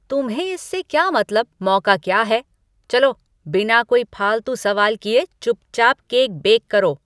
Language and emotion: Hindi, angry